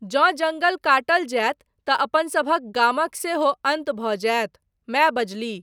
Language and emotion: Maithili, neutral